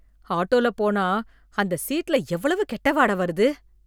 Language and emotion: Tamil, disgusted